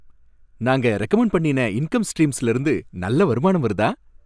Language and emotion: Tamil, happy